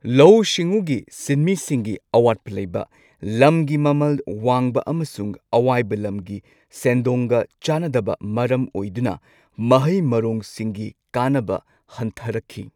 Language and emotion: Manipuri, neutral